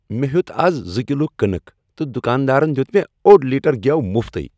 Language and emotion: Kashmiri, happy